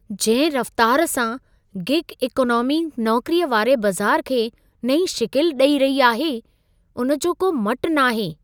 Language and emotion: Sindhi, surprised